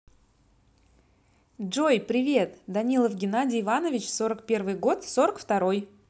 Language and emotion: Russian, positive